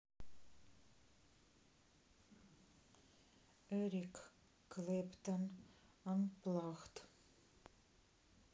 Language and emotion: Russian, neutral